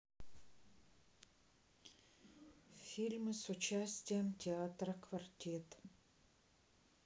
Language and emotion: Russian, sad